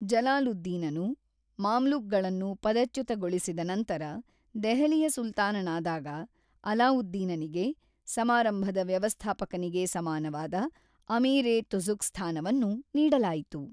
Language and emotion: Kannada, neutral